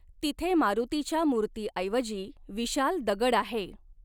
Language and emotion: Marathi, neutral